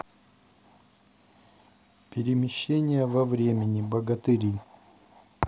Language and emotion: Russian, neutral